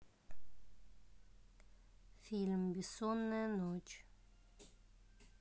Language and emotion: Russian, neutral